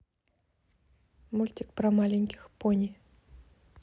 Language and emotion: Russian, neutral